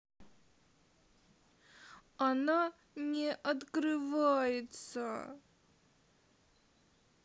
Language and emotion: Russian, sad